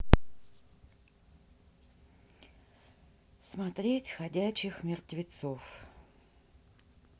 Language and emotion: Russian, neutral